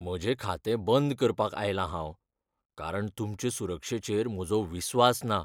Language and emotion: Goan Konkani, fearful